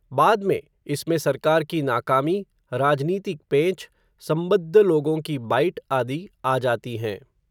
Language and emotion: Hindi, neutral